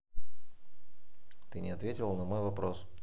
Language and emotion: Russian, neutral